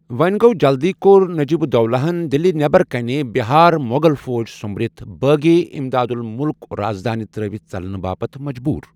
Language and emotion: Kashmiri, neutral